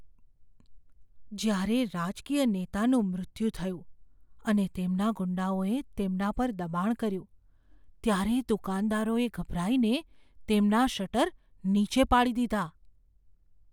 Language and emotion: Gujarati, fearful